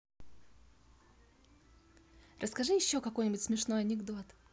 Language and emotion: Russian, positive